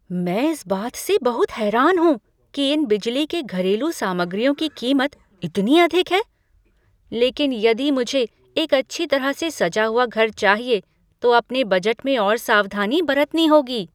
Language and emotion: Hindi, surprised